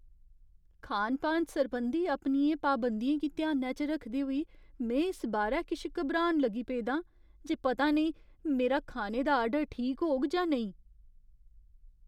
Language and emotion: Dogri, fearful